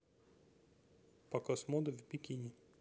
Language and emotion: Russian, neutral